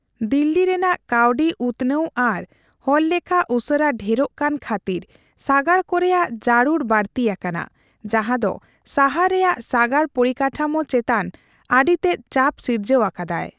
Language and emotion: Santali, neutral